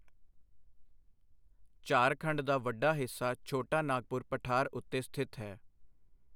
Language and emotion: Punjabi, neutral